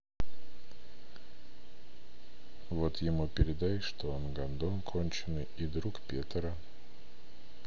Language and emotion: Russian, sad